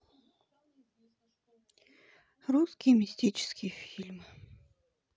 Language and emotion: Russian, sad